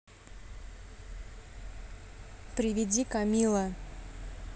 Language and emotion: Russian, neutral